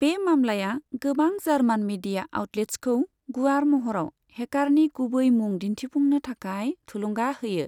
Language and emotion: Bodo, neutral